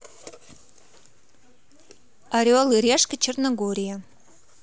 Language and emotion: Russian, positive